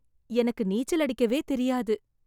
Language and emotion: Tamil, sad